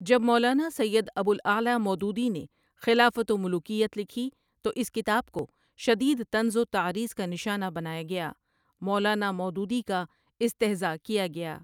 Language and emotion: Urdu, neutral